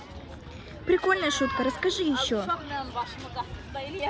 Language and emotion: Russian, positive